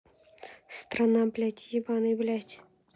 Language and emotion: Russian, angry